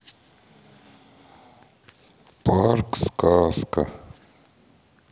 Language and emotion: Russian, sad